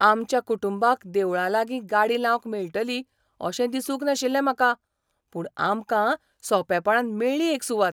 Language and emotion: Goan Konkani, surprised